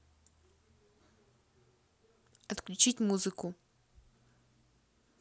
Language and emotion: Russian, neutral